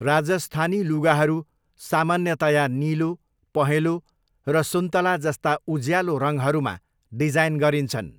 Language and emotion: Nepali, neutral